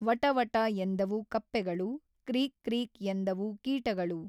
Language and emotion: Kannada, neutral